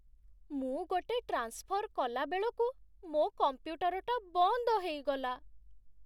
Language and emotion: Odia, sad